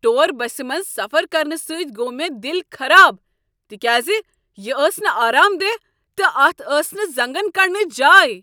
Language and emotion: Kashmiri, angry